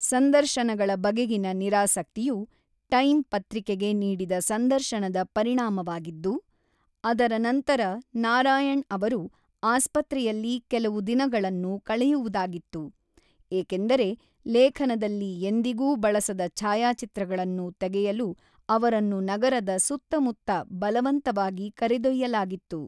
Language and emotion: Kannada, neutral